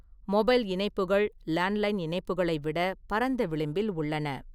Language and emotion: Tamil, neutral